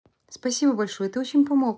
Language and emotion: Russian, neutral